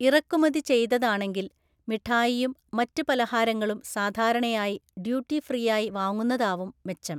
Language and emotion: Malayalam, neutral